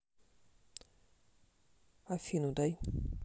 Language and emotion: Russian, neutral